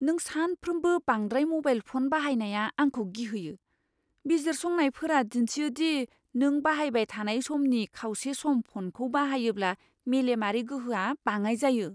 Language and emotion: Bodo, fearful